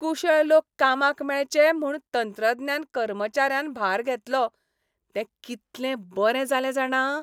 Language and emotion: Goan Konkani, happy